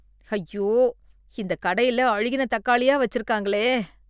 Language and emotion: Tamil, disgusted